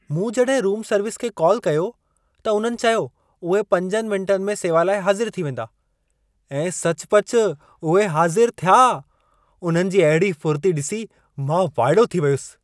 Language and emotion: Sindhi, surprised